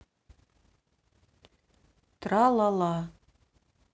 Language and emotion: Russian, neutral